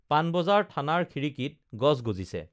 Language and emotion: Assamese, neutral